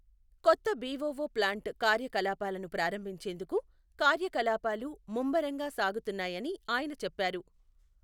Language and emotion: Telugu, neutral